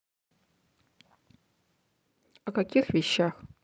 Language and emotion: Russian, neutral